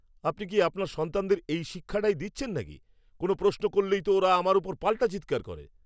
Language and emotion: Bengali, angry